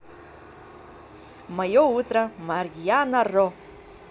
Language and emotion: Russian, positive